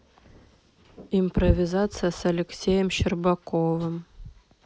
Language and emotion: Russian, neutral